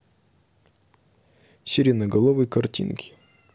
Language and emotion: Russian, neutral